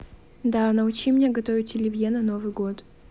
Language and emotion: Russian, neutral